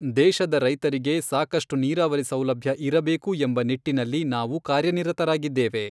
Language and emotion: Kannada, neutral